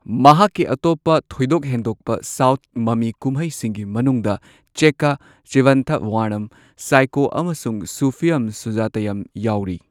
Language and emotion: Manipuri, neutral